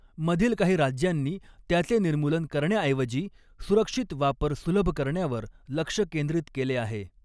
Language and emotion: Marathi, neutral